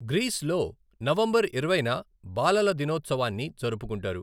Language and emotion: Telugu, neutral